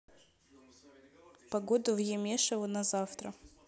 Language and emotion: Russian, neutral